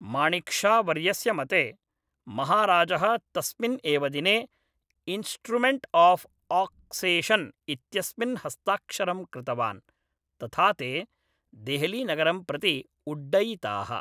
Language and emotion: Sanskrit, neutral